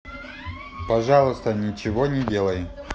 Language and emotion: Russian, neutral